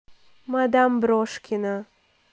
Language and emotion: Russian, neutral